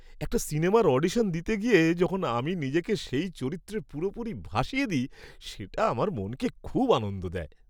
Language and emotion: Bengali, happy